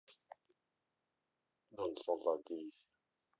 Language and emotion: Russian, neutral